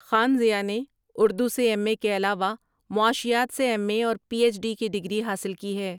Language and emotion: Urdu, neutral